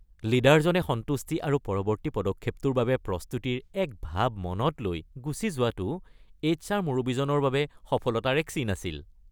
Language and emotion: Assamese, happy